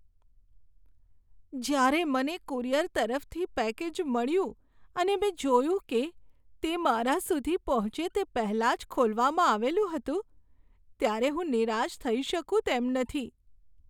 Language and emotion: Gujarati, sad